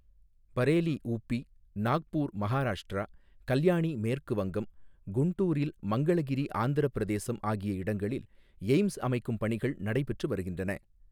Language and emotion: Tamil, neutral